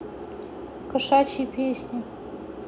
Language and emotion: Russian, neutral